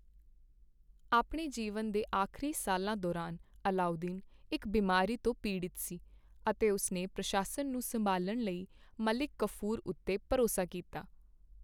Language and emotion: Punjabi, neutral